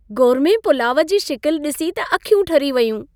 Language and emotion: Sindhi, happy